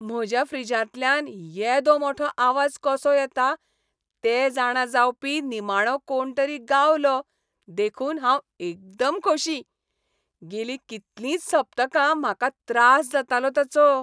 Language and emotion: Goan Konkani, happy